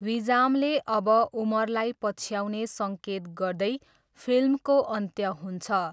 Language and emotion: Nepali, neutral